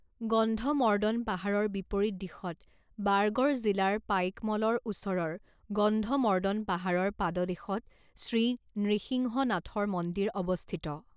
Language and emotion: Assamese, neutral